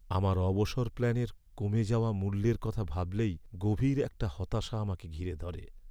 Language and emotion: Bengali, sad